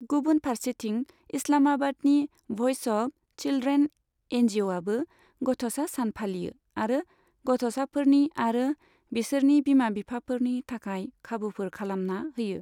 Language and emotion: Bodo, neutral